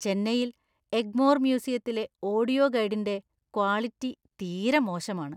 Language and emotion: Malayalam, disgusted